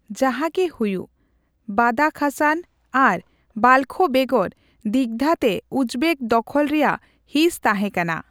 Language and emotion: Santali, neutral